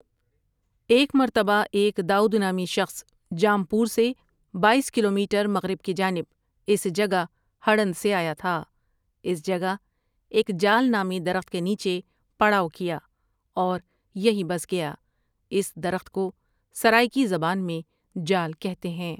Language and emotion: Urdu, neutral